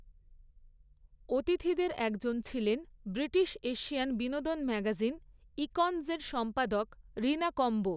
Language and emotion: Bengali, neutral